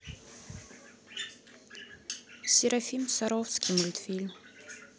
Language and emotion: Russian, neutral